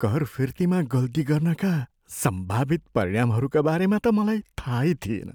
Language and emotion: Nepali, fearful